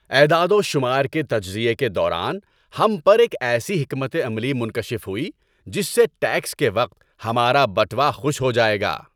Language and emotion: Urdu, happy